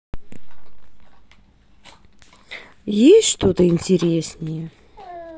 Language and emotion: Russian, sad